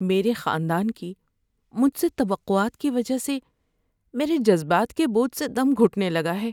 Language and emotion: Urdu, sad